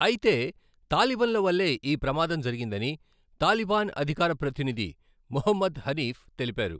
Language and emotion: Telugu, neutral